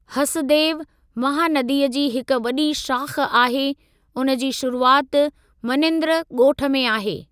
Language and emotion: Sindhi, neutral